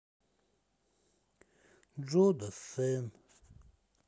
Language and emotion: Russian, sad